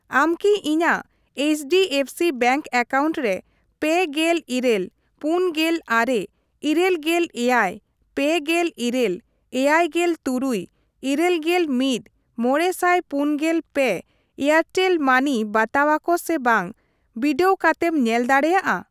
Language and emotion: Santali, neutral